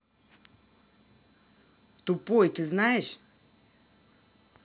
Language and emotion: Russian, angry